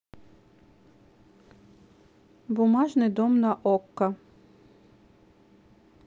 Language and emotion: Russian, neutral